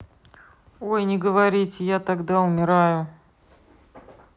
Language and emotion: Russian, neutral